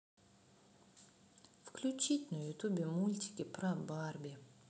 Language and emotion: Russian, sad